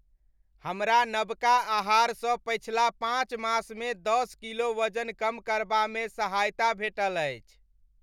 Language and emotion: Maithili, happy